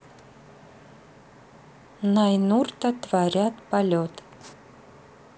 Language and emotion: Russian, neutral